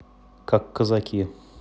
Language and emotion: Russian, neutral